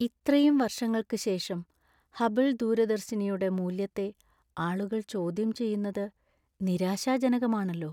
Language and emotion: Malayalam, sad